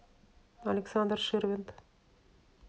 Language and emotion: Russian, neutral